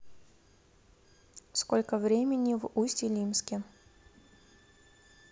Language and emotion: Russian, neutral